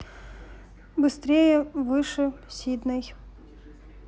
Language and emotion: Russian, neutral